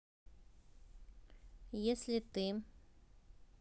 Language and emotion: Russian, neutral